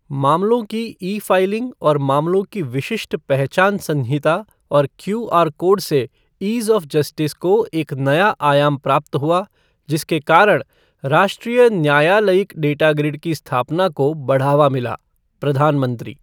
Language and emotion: Hindi, neutral